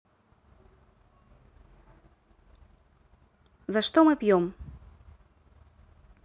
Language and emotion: Russian, neutral